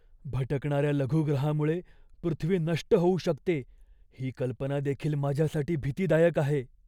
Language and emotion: Marathi, fearful